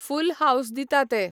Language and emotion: Goan Konkani, neutral